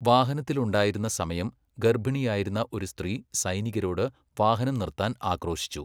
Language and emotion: Malayalam, neutral